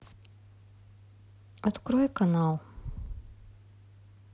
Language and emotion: Russian, neutral